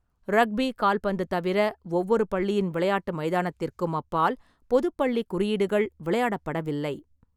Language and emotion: Tamil, neutral